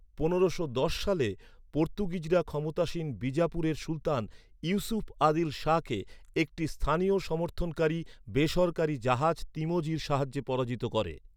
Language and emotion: Bengali, neutral